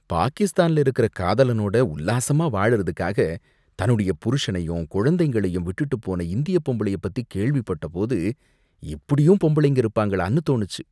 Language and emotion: Tamil, disgusted